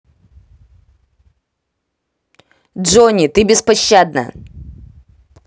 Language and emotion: Russian, angry